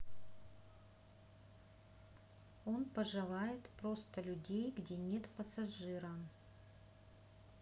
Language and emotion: Russian, neutral